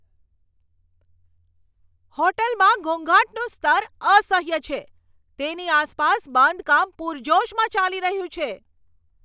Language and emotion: Gujarati, angry